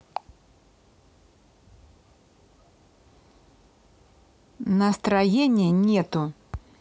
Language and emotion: Russian, angry